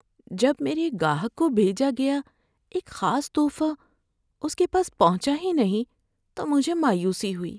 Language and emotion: Urdu, sad